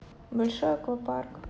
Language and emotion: Russian, neutral